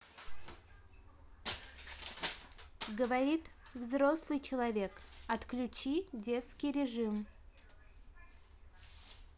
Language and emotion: Russian, neutral